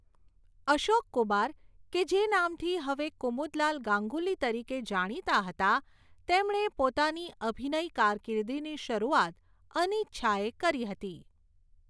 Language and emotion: Gujarati, neutral